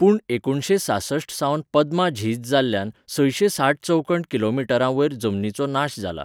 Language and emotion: Goan Konkani, neutral